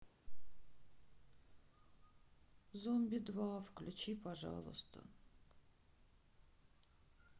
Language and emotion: Russian, sad